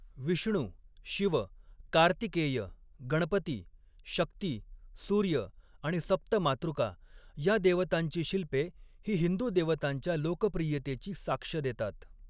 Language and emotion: Marathi, neutral